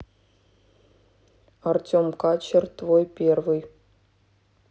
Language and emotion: Russian, neutral